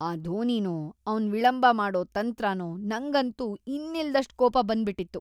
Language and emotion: Kannada, disgusted